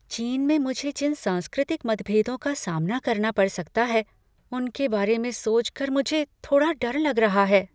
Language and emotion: Hindi, fearful